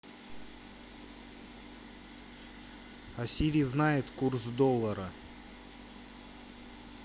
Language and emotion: Russian, neutral